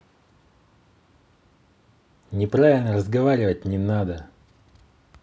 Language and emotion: Russian, angry